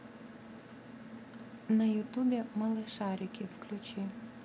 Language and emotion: Russian, neutral